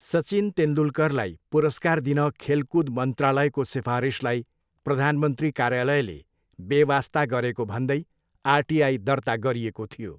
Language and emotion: Nepali, neutral